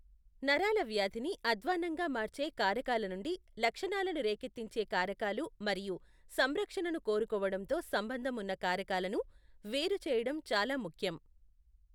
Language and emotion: Telugu, neutral